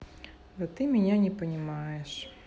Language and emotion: Russian, sad